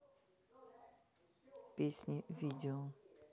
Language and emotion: Russian, neutral